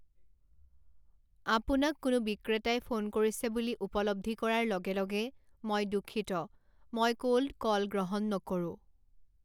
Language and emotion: Assamese, neutral